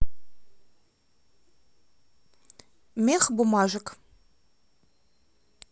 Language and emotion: Russian, neutral